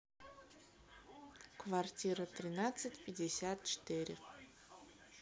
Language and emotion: Russian, neutral